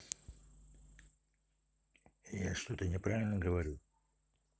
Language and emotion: Russian, neutral